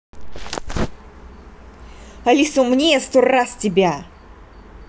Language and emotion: Russian, angry